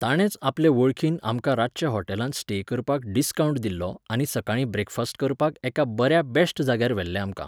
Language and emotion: Goan Konkani, neutral